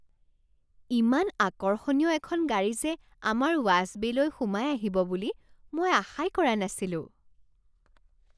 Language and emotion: Assamese, surprised